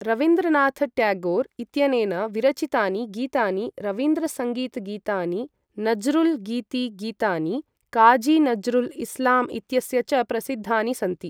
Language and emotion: Sanskrit, neutral